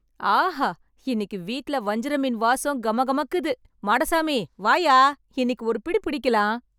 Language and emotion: Tamil, happy